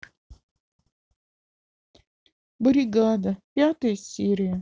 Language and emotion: Russian, sad